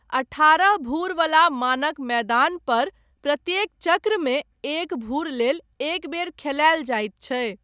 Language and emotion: Maithili, neutral